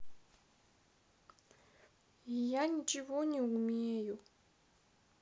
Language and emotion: Russian, sad